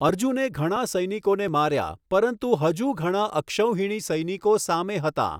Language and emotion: Gujarati, neutral